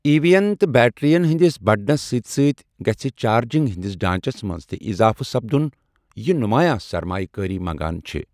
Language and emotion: Kashmiri, neutral